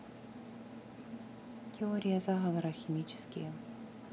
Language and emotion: Russian, neutral